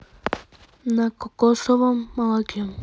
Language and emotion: Russian, neutral